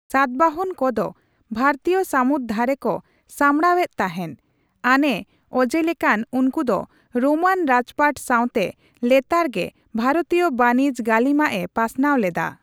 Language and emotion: Santali, neutral